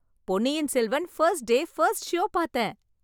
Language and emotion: Tamil, happy